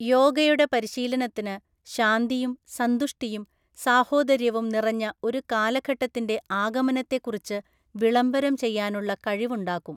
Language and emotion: Malayalam, neutral